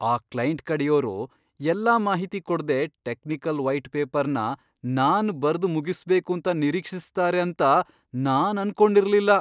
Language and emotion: Kannada, surprised